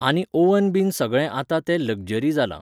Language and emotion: Goan Konkani, neutral